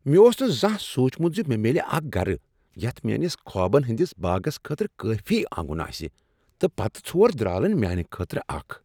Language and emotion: Kashmiri, surprised